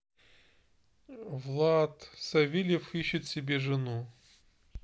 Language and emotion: Russian, neutral